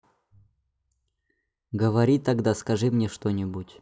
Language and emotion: Russian, neutral